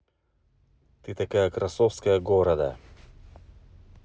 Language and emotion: Russian, neutral